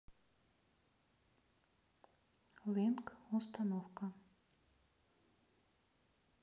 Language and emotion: Russian, neutral